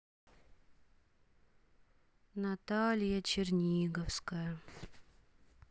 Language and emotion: Russian, sad